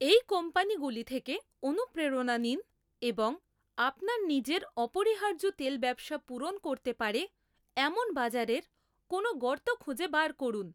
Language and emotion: Bengali, neutral